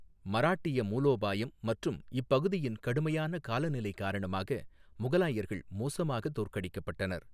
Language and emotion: Tamil, neutral